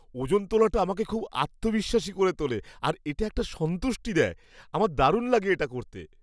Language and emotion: Bengali, happy